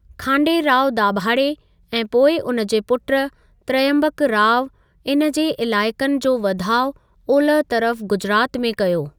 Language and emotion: Sindhi, neutral